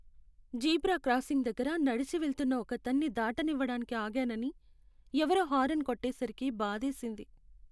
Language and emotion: Telugu, sad